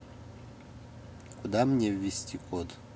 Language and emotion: Russian, neutral